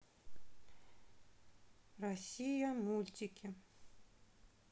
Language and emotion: Russian, neutral